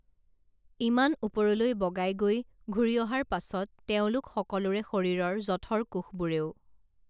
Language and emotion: Assamese, neutral